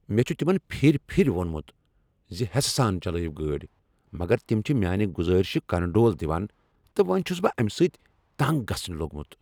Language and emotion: Kashmiri, angry